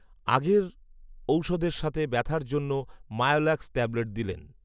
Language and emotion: Bengali, neutral